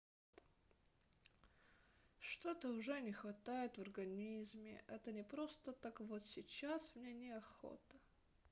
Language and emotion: Russian, sad